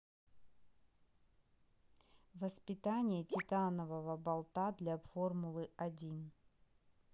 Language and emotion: Russian, neutral